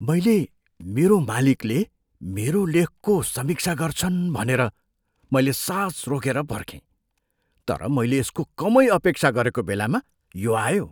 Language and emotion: Nepali, surprised